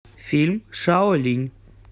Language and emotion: Russian, neutral